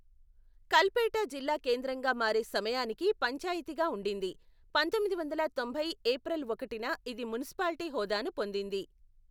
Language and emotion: Telugu, neutral